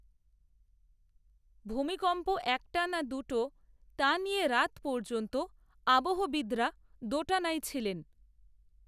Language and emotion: Bengali, neutral